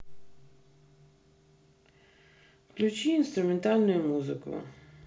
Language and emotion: Russian, neutral